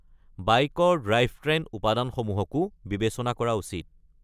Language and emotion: Assamese, neutral